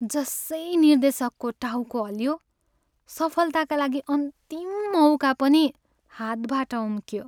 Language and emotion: Nepali, sad